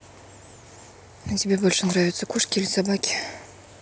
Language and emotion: Russian, neutral